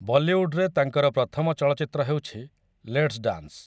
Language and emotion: Odia, neutral